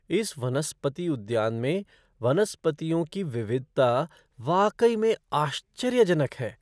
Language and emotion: Hindi, surprised